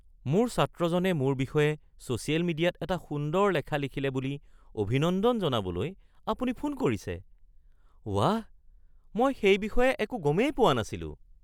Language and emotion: Assamese, surprised